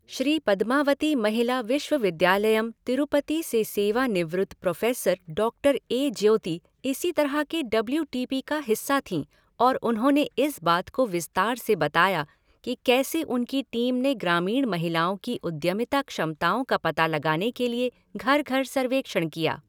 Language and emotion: Hindi, neutral